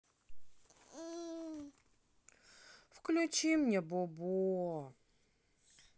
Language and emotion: Russian, sad